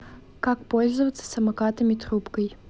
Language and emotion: Russian, neutral